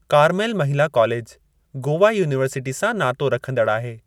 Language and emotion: Sindhi, neutral